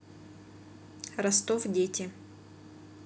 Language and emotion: Russian, neutral